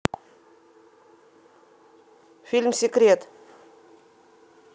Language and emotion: Russian, neutral